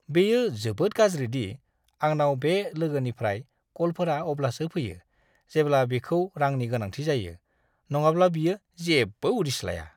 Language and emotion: Bodo, disgusted